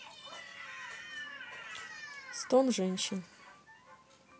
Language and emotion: Russian, neutral